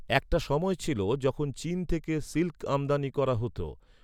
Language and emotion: Bengali, neutral